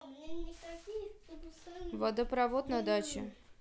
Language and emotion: Russian, neutral